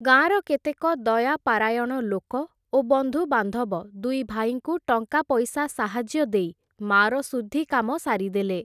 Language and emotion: Odia, neutral